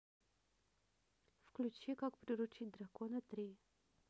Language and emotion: Russian, neutral